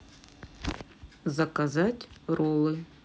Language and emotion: Russian, neutral